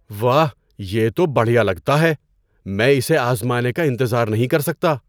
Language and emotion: Urdu, surprised